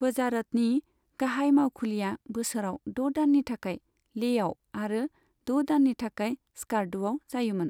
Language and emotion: Bodo, neutral